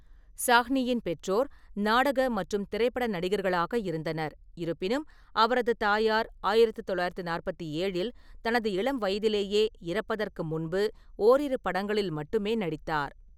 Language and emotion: Tamil, neutral